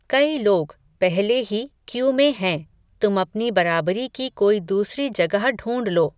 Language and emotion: Hindi, neutral